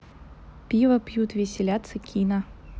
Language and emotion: Russian, neutral